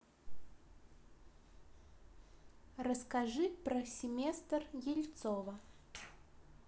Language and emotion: Russian, neutral